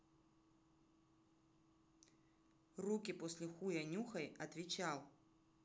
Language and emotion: Russian, angry